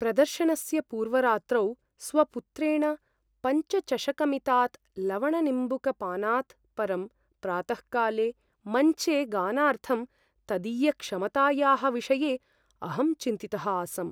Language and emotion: Sanskrit, fearful